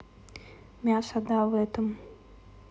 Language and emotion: Russian, neutral